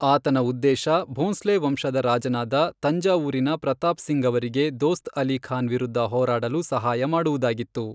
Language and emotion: Kannada, neutral